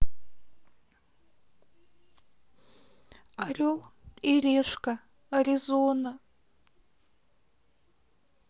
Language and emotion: Russian, sad